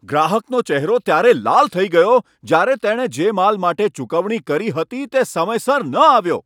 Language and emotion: Gujarati, angry